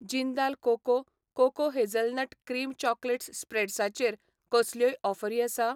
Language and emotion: Goan Konkani, neutral